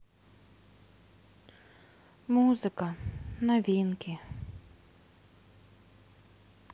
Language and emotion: Russian, sad